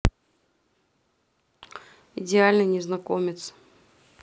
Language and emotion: Russian, neutral